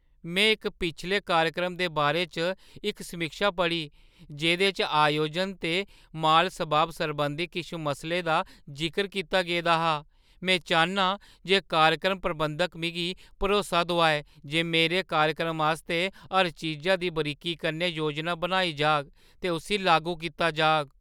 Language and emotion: Dogri, fearful